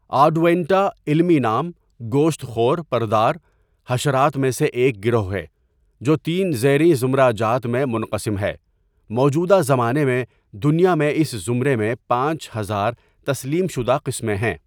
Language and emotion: Urdu, neutral